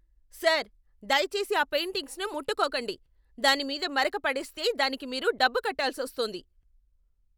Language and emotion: Telugu, angry